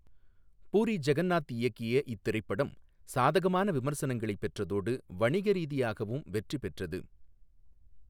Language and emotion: Tamil, neutral